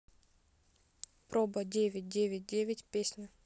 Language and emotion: Russian, neutral